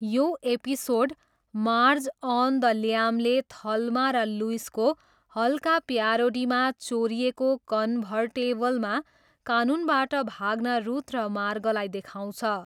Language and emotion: Nepali, neutral